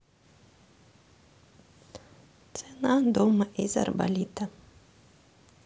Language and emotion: Russian, neutral